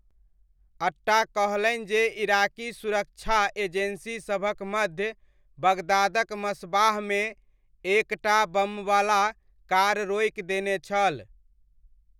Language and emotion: Maithili, neutral